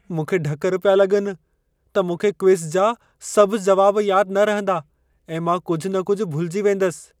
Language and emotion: Sindhi, fearful